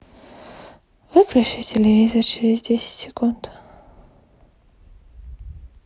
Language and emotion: Russian, sad